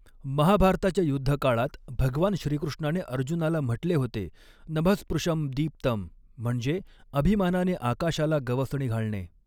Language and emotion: Marathi, neutral